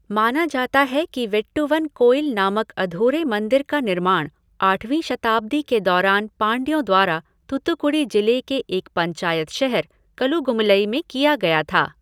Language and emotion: Hindi, neutral